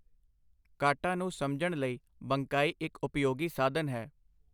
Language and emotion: Punjabi, neutral